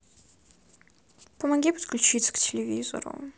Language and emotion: Russian, sad